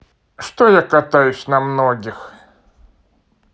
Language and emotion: Russian, neutral